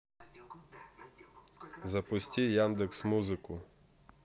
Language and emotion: Russian, neutral